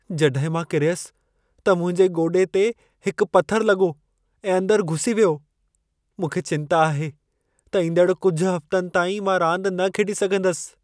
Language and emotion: Sindhi, fearful